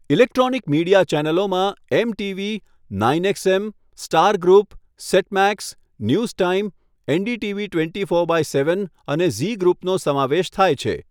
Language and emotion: Gujarati, neutral